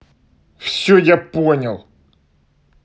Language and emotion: Russian, angry